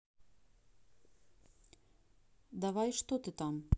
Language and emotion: Russian, neutral